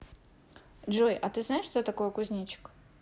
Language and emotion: Russian, neutral